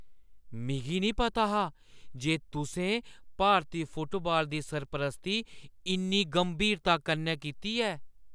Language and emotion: Dogri, surprised